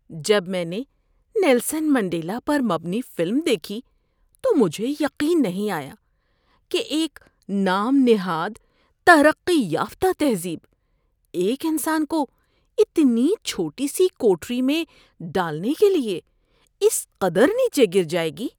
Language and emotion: Urdu, disgusted